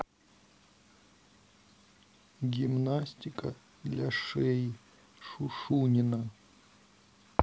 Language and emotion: Russian, sad